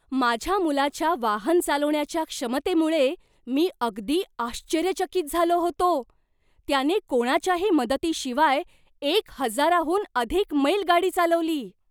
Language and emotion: Marathi, surprised